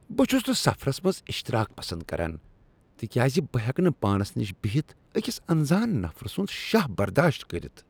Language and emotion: Kashmiri, disgusted